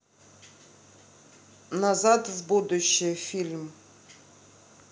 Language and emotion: Russian, neutral